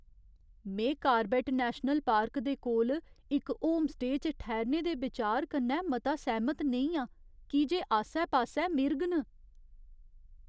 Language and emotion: Dogri, fearful